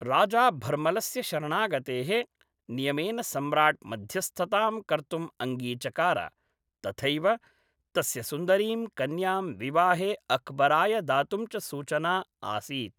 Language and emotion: Sanskrit, neutral